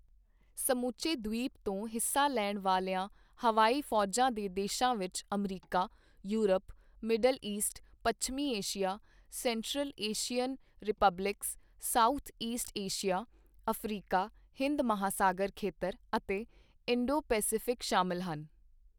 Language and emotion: Punjabi, neutral